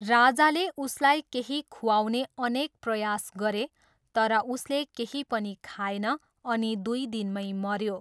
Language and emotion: Nepali, neutral